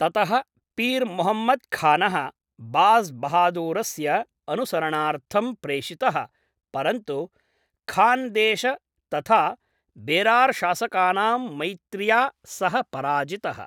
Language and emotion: Sanskrit, neutral